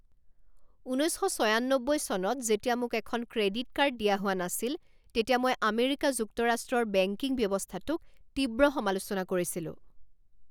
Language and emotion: Assamese, angry